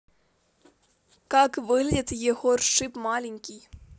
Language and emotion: Russian, neutral